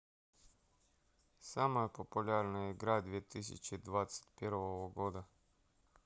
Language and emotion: Russian, neutral